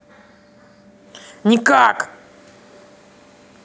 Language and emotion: Russian, angry